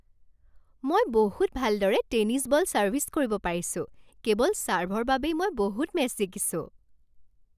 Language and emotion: Assamese, happy